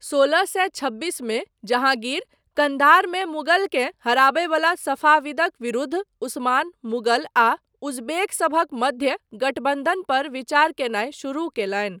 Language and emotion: Maithili, neutral